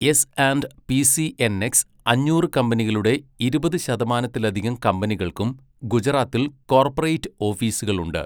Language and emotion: Malayalam, neutral